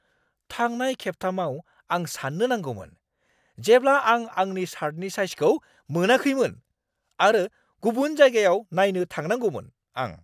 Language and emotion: Bodo, angry